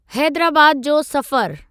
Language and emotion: Sindhi, neutral